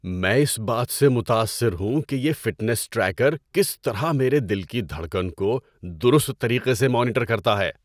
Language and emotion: Urdu, surprised